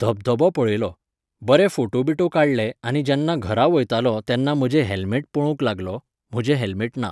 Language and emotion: Goan Konkani, neutral